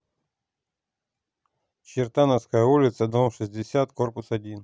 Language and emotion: Russian, neutral